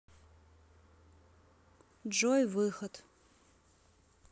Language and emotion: Russian, neutral